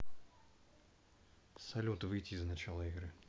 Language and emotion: Russian, neutral